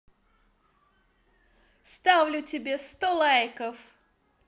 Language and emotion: Russian, positive